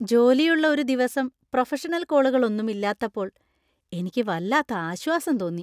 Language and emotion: Malayalam, happy